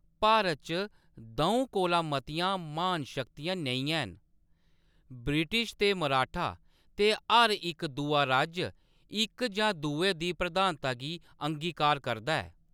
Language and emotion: Dogri, neutral